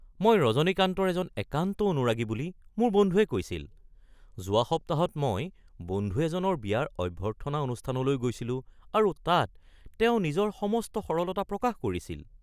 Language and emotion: Assamese, surprised